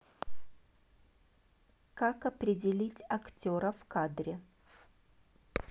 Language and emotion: Russian, neutral